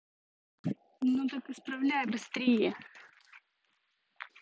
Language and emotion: Russian, angry